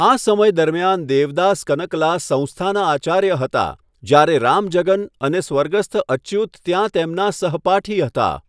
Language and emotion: Gujarati, neutral